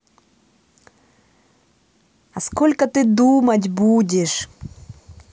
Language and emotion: Russian, angry